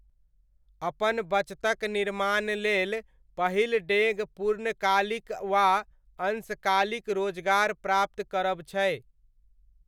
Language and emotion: Maithili, neutral